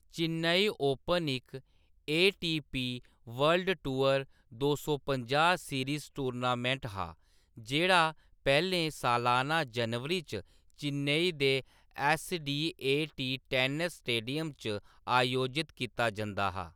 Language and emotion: Dogri, neutral